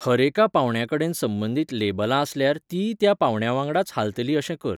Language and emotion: Goan Konkani, neutral